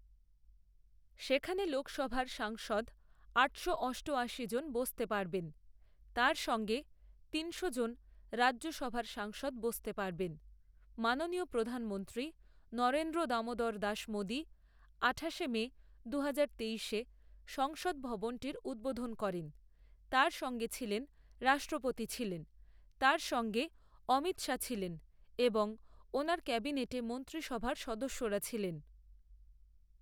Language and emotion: Bengali, neutral